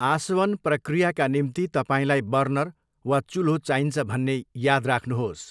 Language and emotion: Nepali, neutral